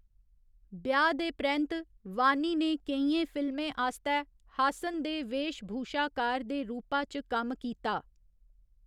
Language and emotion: Dogri, neutral